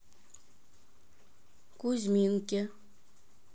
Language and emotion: Russian, neutral